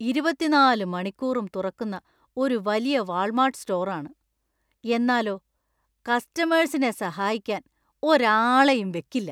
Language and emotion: Malayalam, disgusted